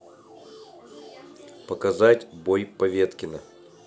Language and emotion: Russian, neutral